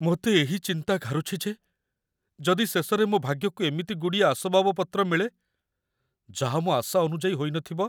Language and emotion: Odia, fearful